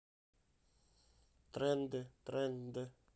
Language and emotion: Russian, neutral